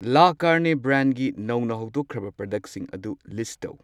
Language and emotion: Manipuri, neutral